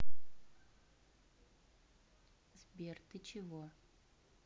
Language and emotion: Russian, neutral